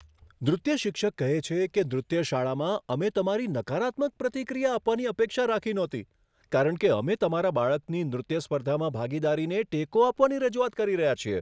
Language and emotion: Gujarati, surprised